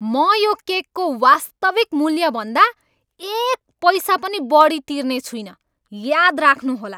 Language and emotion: Nepali, angry